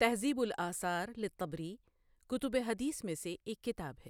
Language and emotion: Urdu, neutral